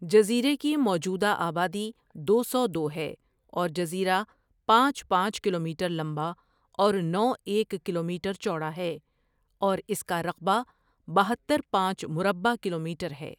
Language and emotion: Urdu, neutral